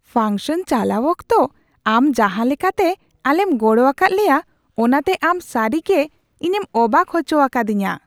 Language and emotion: Santali, surprised